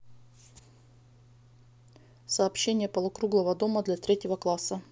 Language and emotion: Russian, neutral